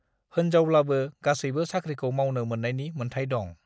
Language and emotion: Bodo, neutral